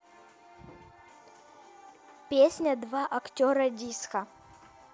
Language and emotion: Russian, neutral